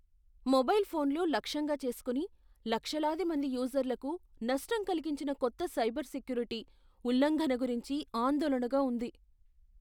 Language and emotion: Telugu, fearful